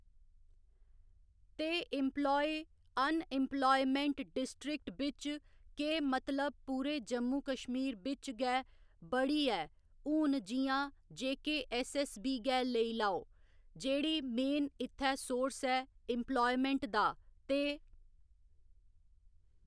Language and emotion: Dogri, neutral